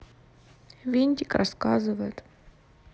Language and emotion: Russian, neutral